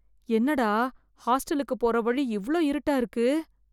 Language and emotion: Tamil, fearful